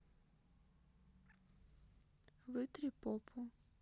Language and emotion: Russian, neutral